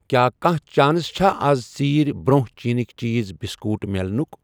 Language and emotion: Kashmiri, neutral